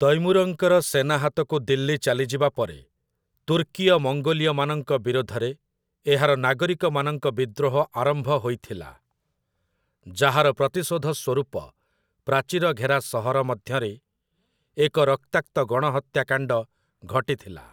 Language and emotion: Odia, neutral